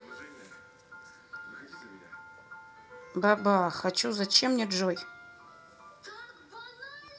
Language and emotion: Russian, neutral